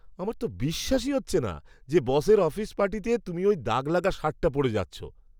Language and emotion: Bengali, disgusted